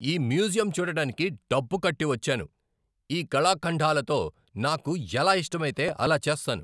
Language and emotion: Telugu, angry